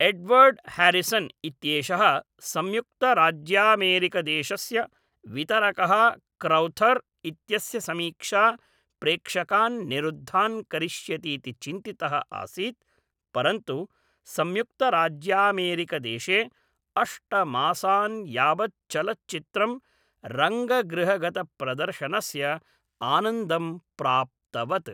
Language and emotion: Sanskrit, neutral